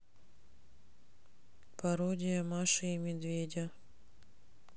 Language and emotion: Russian, neutral